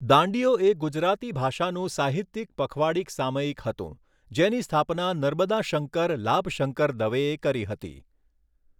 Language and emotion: Gujarati, neutral